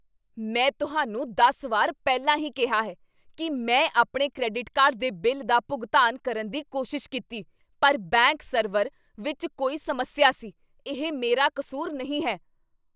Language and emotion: Punjabi, angry